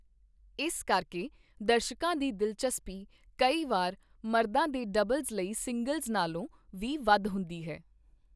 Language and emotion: Punjabi, neutral